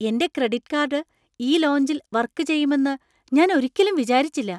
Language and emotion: Malayalam, surprised